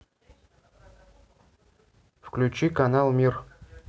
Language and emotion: Russian, neutral